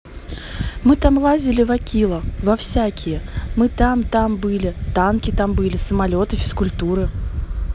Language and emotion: Russian, neutral